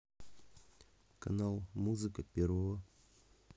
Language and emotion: Russian, neutral